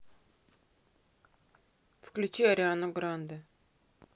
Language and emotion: Russian, neutral